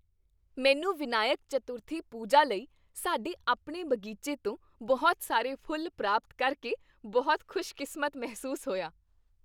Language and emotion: Punjabi, happy